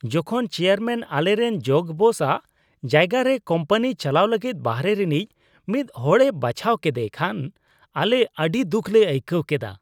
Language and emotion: Santali, disgusted